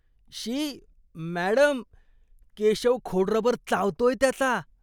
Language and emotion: Marathi, disgusted